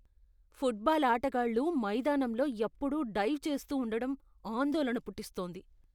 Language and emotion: Telugu, disgusted